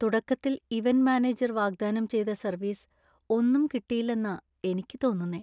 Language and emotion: Malayalam, sad